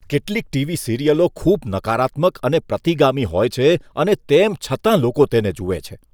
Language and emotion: Gujarati, disgusted